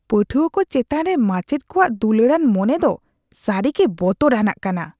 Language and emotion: Santali, disgusted